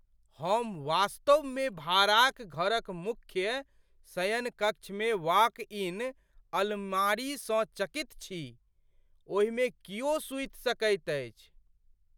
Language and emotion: Maithili, surprised